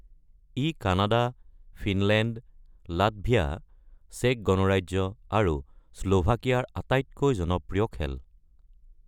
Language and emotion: Assamese, neutral